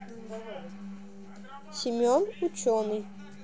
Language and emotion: Russian, neutral